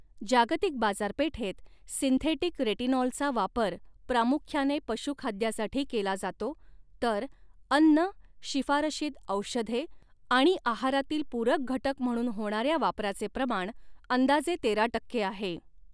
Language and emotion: Marathi, neutral